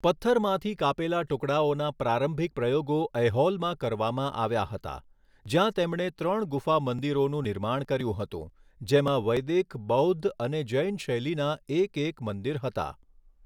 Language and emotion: Gujarati, neutral